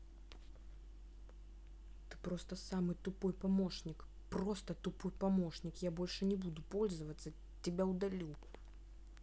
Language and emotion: Russian, angry